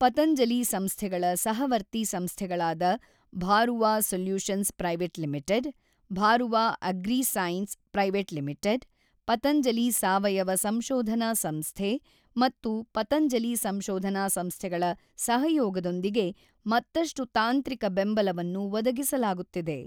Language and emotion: Kannada, neutral